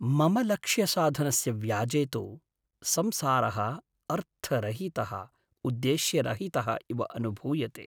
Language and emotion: Sanskrit, sad